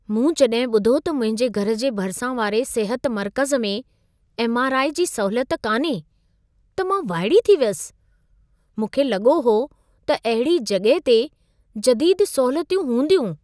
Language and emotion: Sindhi, surprised